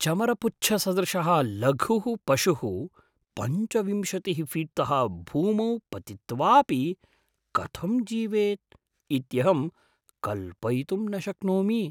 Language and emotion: Sanskrit, surprised